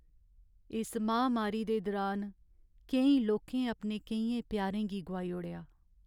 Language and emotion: Dogri, sad